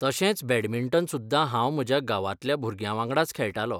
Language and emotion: Goan Konkani, neutral